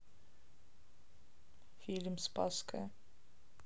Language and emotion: Russian, neutral